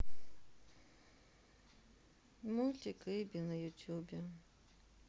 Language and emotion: Russian, sad